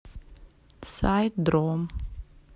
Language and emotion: Russian, neutral